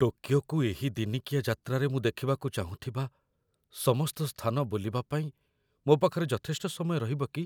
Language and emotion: Odia, fearful